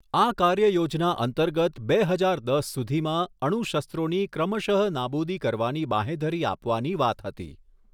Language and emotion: Gujarati, neutral